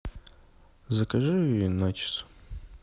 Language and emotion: Russian, neutral